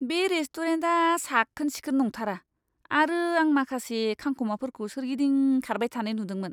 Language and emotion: Bodo, disgusted